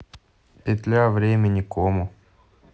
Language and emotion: Russian, neutral